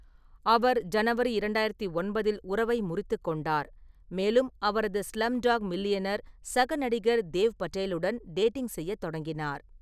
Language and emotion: Tamil, neutral